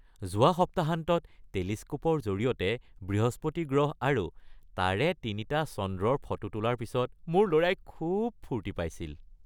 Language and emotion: Assamese, happy